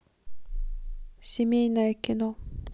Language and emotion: Russian, neutral